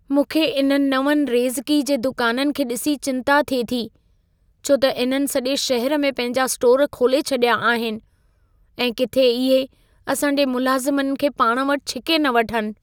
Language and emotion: Sindhi, fearful